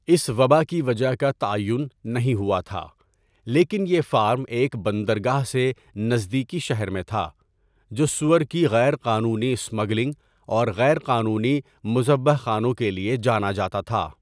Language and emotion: Urdu, neutral